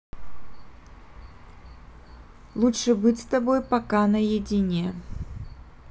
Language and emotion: Russian, neutral